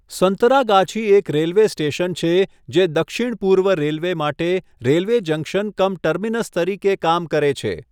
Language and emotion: Gujarati, neutral